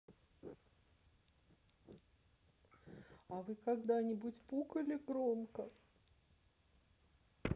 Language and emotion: Russian, sad